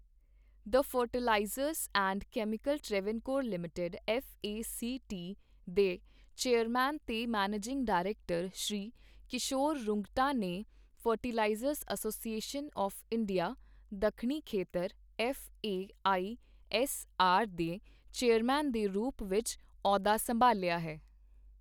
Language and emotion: Punjabi, neutral